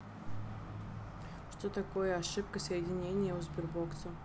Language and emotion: Russian, neutral